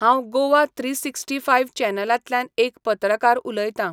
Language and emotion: Goan Konkani, neutral